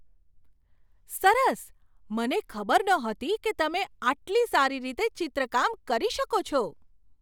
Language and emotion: Gujarati, surprised